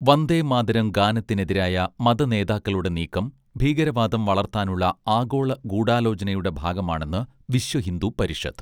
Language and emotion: Malayalam, neutral